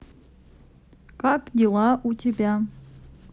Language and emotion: Russian, neutral